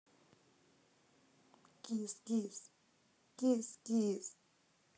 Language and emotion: Russian, angry